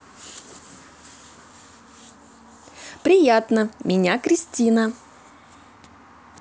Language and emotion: Russian, positive